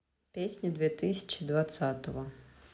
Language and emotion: Russian, neutral